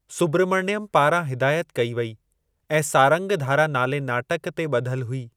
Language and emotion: Sindhi, neutral